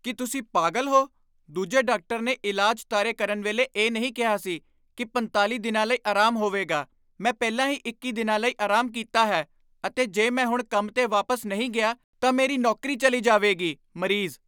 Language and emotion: Punjabi, angry